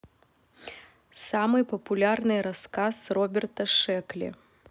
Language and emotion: Russian, neutral